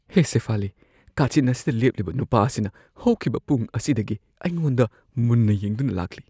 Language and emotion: Manipuri, fearful